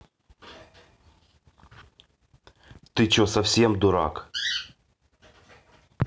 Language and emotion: Russian, angry